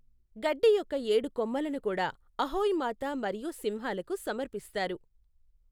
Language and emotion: Telugu, neutral